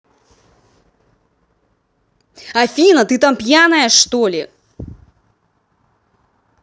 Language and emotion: Russian, angry